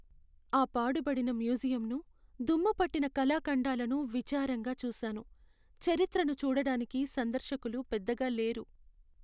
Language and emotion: Telugu, sad